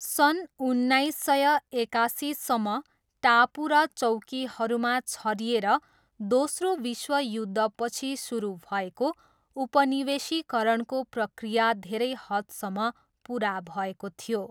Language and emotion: Nepali, neutral